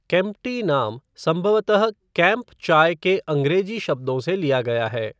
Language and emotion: Hindi, neutral